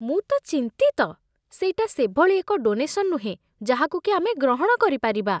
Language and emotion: Odia, disgusted